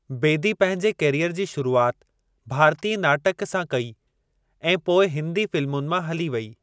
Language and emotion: Sindhi, neutral